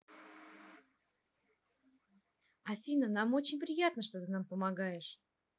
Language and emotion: Russian, positive